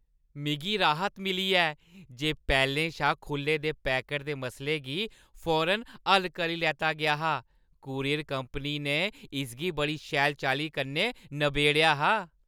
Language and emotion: Dogri, happy